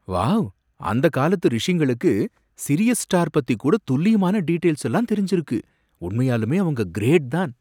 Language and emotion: Tamil, surprised